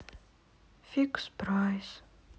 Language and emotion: Russian, sad